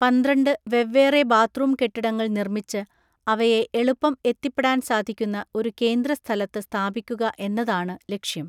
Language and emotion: Malayalam, neutral